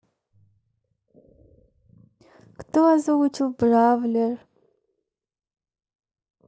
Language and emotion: Russian, neutral